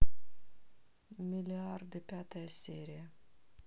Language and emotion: Russian, sad